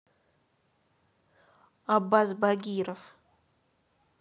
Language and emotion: Russian, neutral